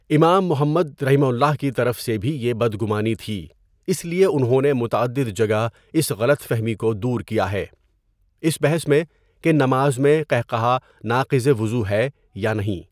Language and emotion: Urdu, neutral